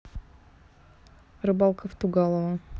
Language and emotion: Russian, neutral